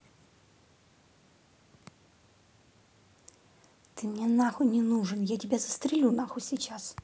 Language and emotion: Russian, angry